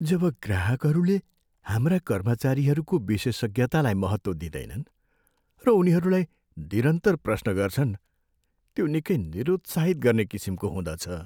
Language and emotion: Nepali, sad